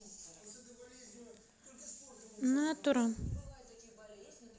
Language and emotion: Russian, neutral